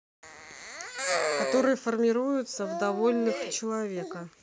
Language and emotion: Russian, neutral